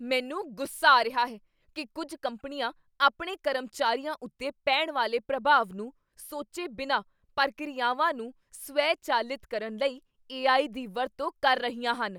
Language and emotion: Punjabi, angry